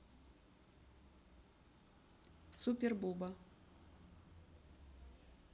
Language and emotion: Russian, neutral